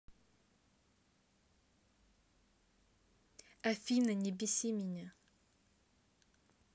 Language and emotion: Russian, angry